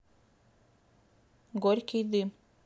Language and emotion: Russian, neutral